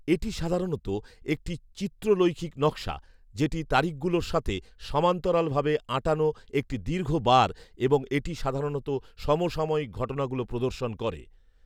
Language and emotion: Bengali, neutral